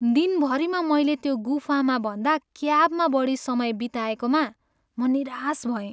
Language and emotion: Nepali, sad